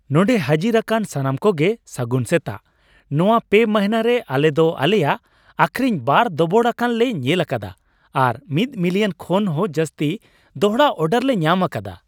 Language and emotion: Santali, happy